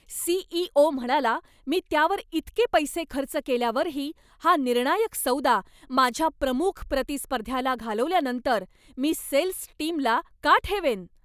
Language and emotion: Marathi, angry